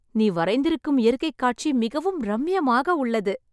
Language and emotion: Tamil, happy